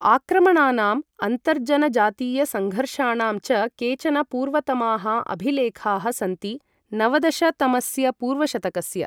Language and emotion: Sanskrit, neutral